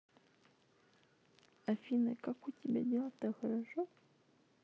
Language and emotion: Russian, neutral